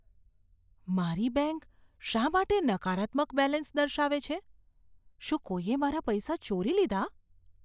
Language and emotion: Gujarati, fearful